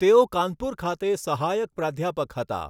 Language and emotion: Gujarati, neutral